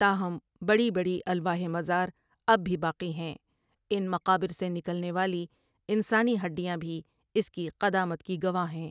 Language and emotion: Urdu, neutral